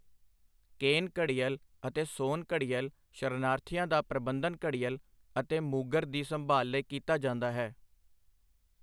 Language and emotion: Punjabi, neutral